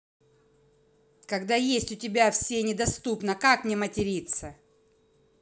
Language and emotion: Russian, angry